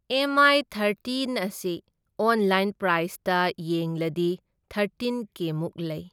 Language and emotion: Manipuri, neutral